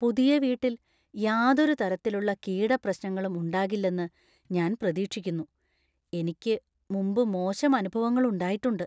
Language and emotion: Malayalam, fearful